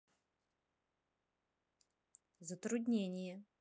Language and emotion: Russian, neutral